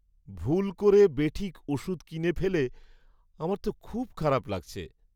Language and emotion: Bengali, sad